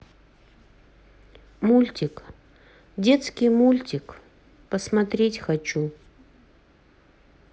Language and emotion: Russian, sad